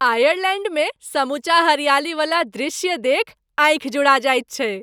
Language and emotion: Maithili, happy